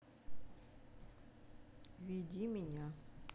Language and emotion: Russian, neutral